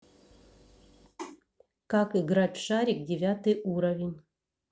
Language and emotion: Russian, neutral